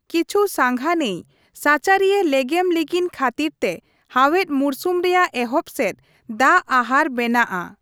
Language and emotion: Santali, neutral